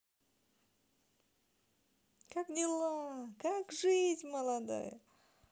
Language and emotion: Russian, positive